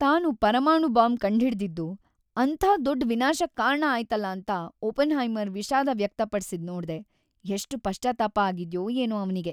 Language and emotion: Kannada, sad